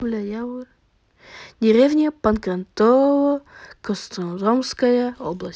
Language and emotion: Russian, neutral